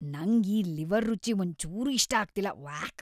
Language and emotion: Kannada, disgusted